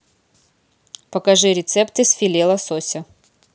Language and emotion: Russian, neutral